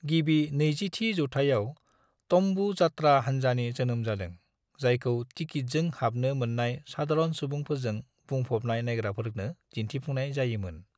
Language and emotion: Bodo, neutral